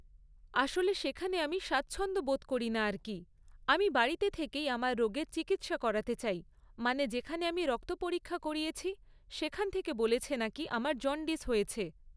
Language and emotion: Bengali, neutral